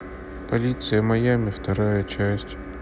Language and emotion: Russian, neutral